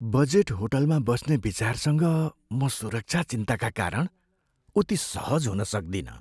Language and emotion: Nepali, fearful